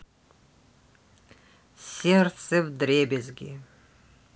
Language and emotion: Russian, neutral